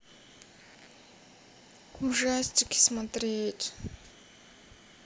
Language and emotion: Russian, sad